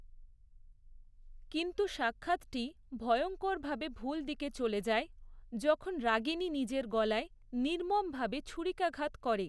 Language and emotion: Bengali, neutral